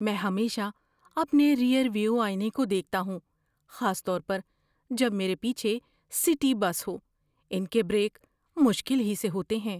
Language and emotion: Urdu, fearful